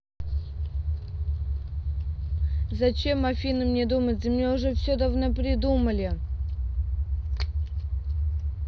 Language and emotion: Russian, angry